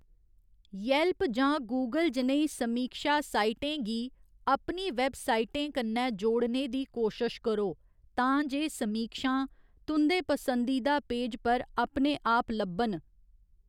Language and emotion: Dogri, neutral